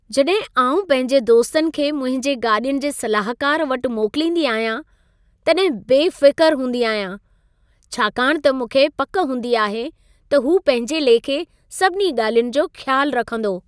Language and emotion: Sindhi, happy